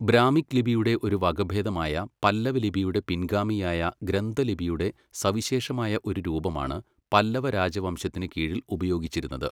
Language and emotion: Malayalam, neutral